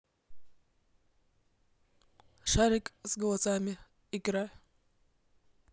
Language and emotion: Russian, neutral